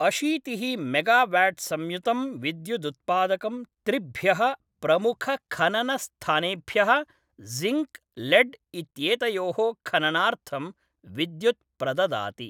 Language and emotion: Sanskrit, neutral